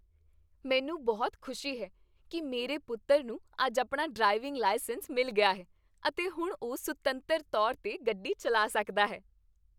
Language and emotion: Punjabi, happy